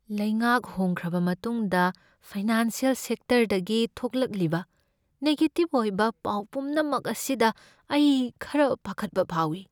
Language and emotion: Manipuri, fearful